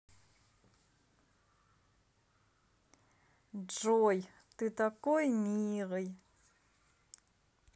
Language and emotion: Russian, positive